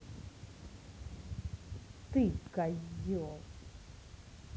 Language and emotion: Russian, angry